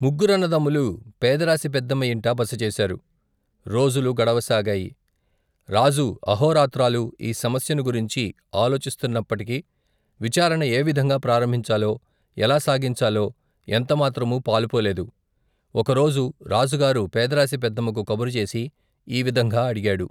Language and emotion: Telugu, neutral